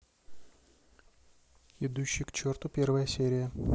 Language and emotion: Russian, neutral